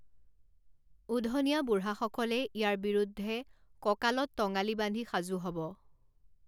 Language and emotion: Assamese, neutral